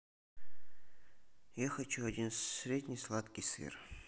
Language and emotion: Russian, neutral